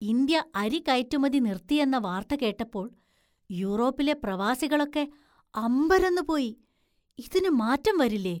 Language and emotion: Malayalam, surprised